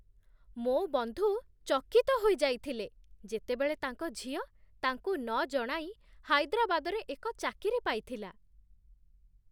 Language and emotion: Odia, surprised